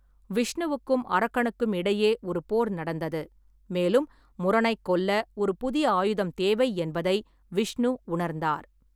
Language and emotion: Tamil, neutral